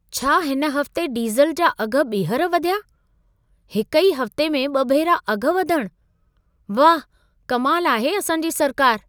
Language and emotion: Sindhi, surprised